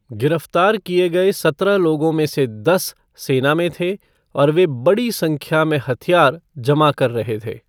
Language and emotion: Hindi, neutral